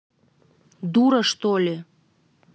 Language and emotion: Russian, angry